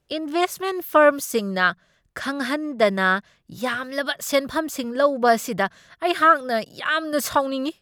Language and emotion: Manipuri, angry